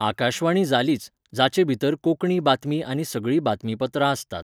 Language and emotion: Goan Konkani, neutral